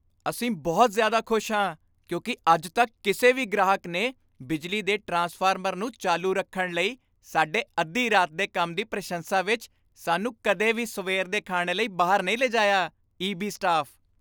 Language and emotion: Punjabi, happy